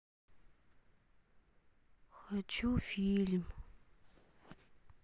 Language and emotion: Russian, sad